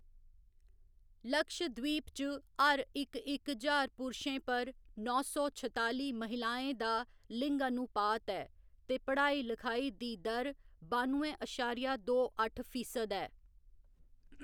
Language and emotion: Dogri, neutral